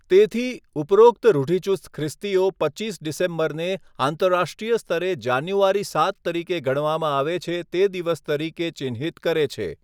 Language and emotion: Gujarati, neutral